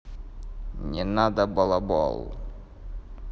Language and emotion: Russian, neutral